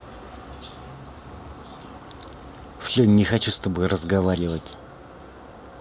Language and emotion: Russian, angry